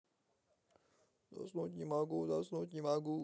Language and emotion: Russian, sad